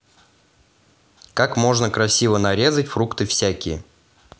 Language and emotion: Russian, neutral